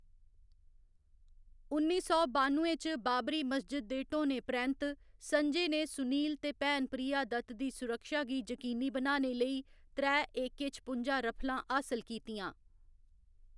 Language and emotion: Dogri, neutral